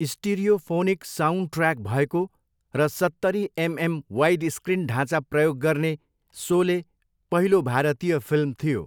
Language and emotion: Nepali, neutral